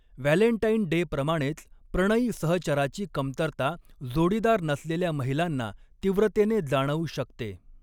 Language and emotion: Marathi, neutral